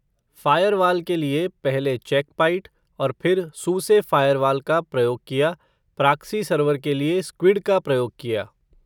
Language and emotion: Hindi, neutral